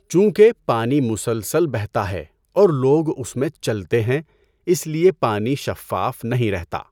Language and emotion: Urdu, neutral